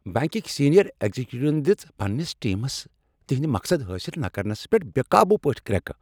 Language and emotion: Kashmiri, angry